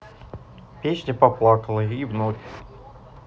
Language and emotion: Russian, neutral